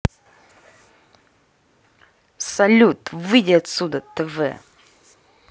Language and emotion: Russian, angry